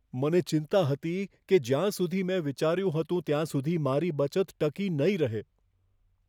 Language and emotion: Gujarati, fearful